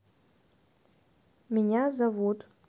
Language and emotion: Russian, neutral